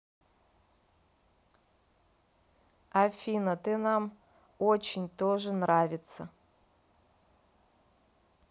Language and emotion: Russian, neutral